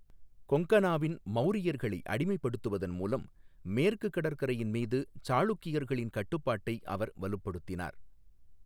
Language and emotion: Tamil, neutral